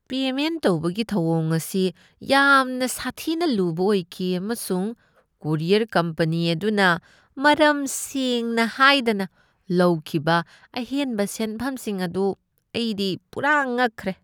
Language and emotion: Manipuri, disgusted